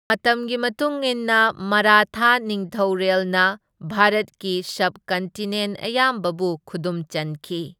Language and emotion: Manipuri, neutral